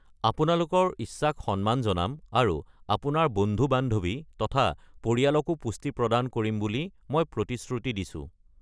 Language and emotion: Assamese, neutral